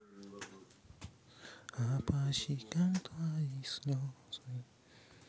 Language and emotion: Russian, sad